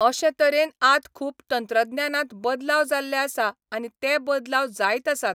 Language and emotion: Goan Konkani, neutral